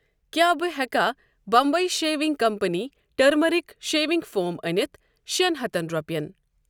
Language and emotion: Kashmiri, neutral